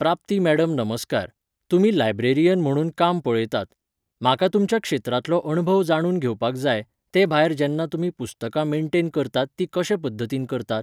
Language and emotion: Goan Konkani, neutral